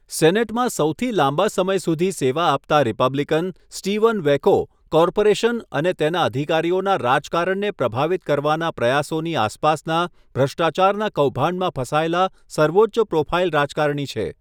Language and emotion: Gujarati, neutral